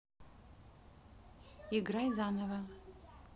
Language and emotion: Russian, neutral